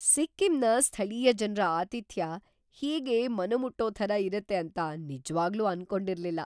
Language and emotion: Kannada, surprised